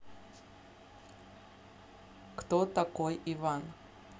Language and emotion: Russian, neutral